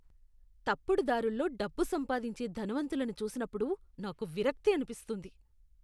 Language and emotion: Telugu, disgusted